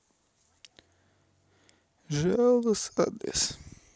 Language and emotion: Russian, sad